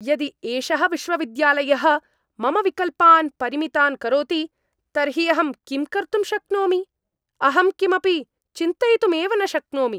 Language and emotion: Sanskrit, angry